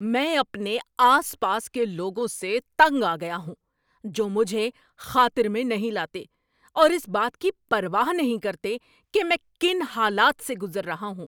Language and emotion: Urdu, angry